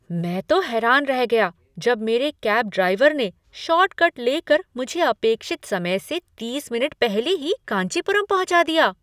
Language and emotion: Hindi, surprised